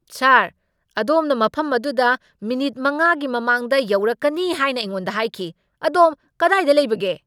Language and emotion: Manipuri, angry